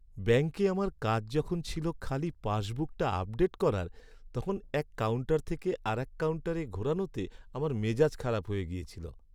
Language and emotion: Bengali, sad